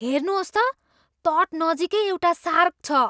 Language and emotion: Nepali, surprised